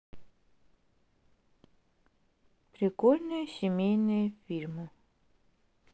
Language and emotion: Russian, neutral